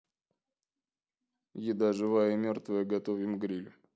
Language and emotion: Russian, neutral